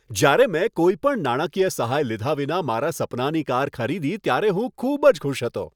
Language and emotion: Gujarati, happy